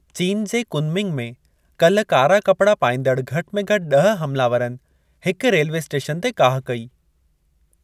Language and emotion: Sindhi, neutral